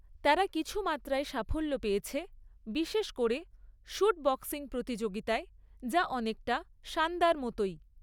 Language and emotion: Bengali, neutral